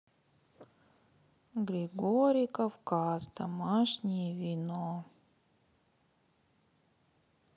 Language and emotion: Russian, sad